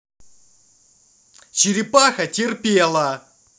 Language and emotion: Russian, angry